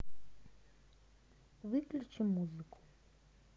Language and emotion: Russian, neutral